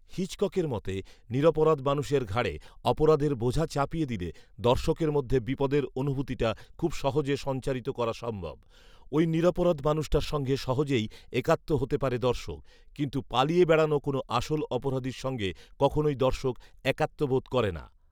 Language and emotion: Bengali, neutral